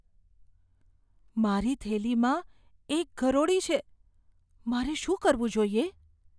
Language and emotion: Gujarati, fearful